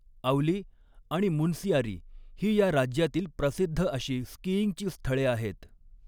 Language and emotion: Marathi, neutral